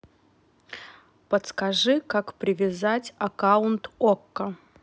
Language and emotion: Russian, neutral